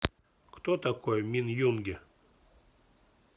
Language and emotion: Russian, neutral